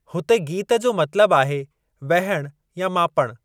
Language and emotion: Sindhi, neutral